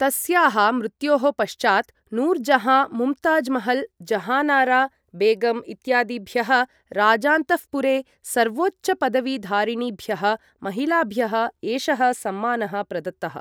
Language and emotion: Sanskrit, neutral